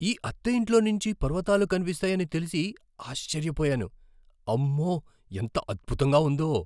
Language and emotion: Telugu, surprised